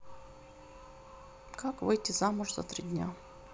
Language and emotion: Russian, neutral